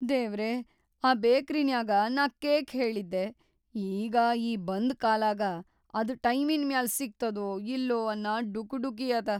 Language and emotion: Kannada, fearful